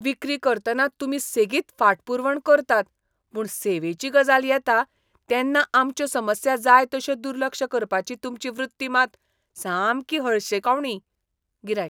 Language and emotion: Goan Konkani, disgusted